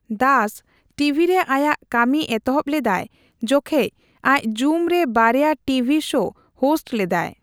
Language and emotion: Santali, neutral